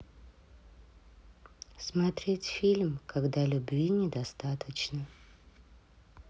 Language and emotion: Russian, sad